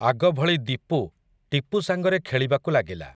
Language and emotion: Odia, neutral